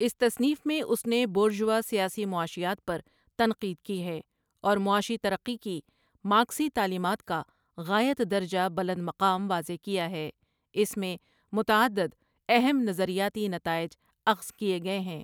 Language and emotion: Urdu, neutral